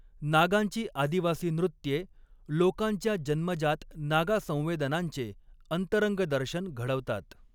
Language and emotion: Marathi, neutral